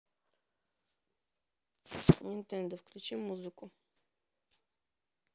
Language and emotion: Russian, neutral